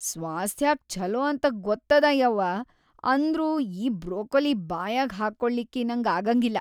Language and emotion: Kannada, disgusted